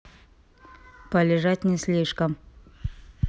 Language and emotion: Russian, neutral